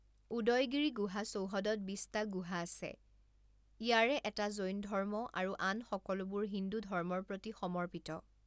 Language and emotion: Assamese, neutral